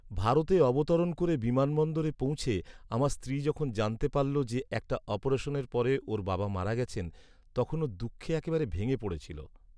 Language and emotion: Bengali, sad